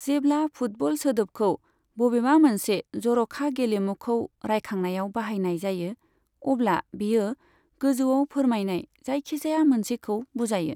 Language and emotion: Bodo, neutral